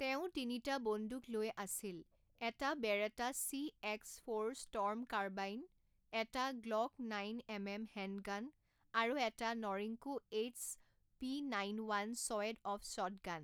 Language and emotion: Assamese, neutral